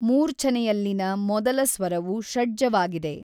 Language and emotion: Kannada, neutral